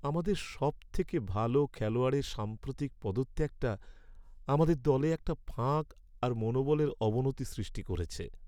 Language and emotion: Bengali, sad